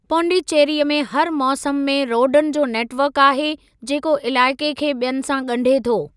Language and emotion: Sindhi, neutral